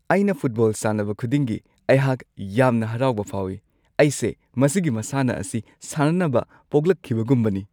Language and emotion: Manipuri, happy